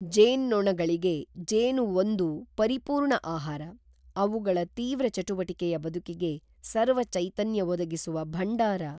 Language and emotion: Kannada, neutral